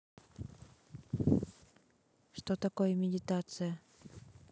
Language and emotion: Russian, neutral